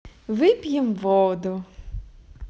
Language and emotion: Russian, positive